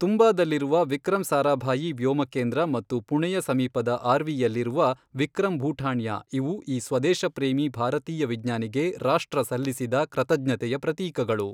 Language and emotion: Kannada, neutral